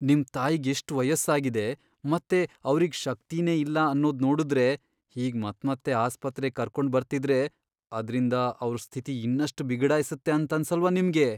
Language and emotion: Kannada, fearful